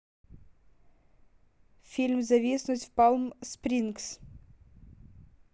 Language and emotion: Russian, neutral